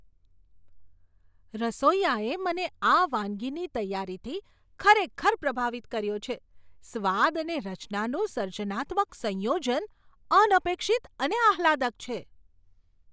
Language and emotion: Gujarati, surprised